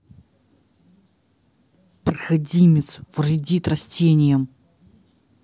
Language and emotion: Russian, angry